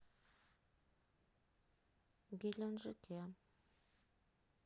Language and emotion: Russian, sad